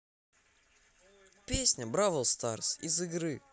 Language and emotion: Russian, positive